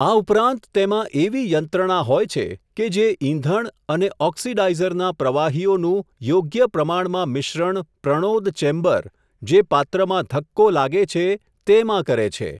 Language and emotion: Gujarati, neutral